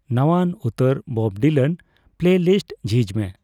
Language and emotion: Santali, neutral